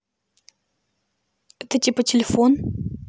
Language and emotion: Russian, neutral